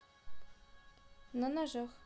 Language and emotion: Russian, neutral